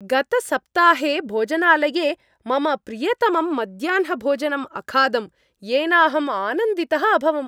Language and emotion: Sanskrit, happy